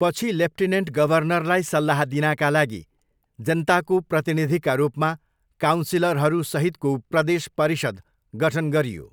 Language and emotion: Nepali, neutral